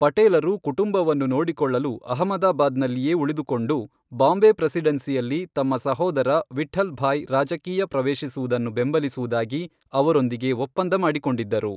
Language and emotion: Kannada, neutral